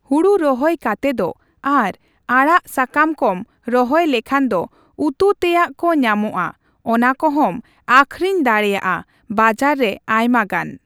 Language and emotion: Santali, neutral